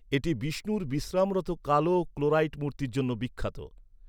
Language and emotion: Bengali, neutral